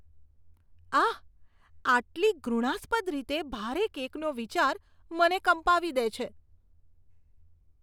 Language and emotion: Gujarati, disgusted